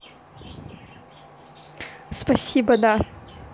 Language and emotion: Russian, positive